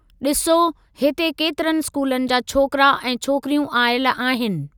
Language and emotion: Sindhi, neutral